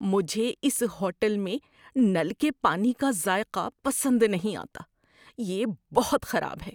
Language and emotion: Urdu, disgusted